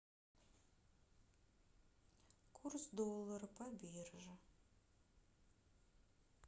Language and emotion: Russian, sad